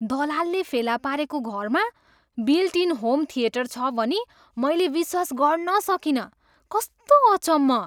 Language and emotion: Nepali, surprised